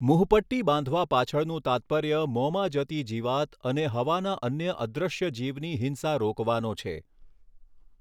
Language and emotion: Gujarati, neutral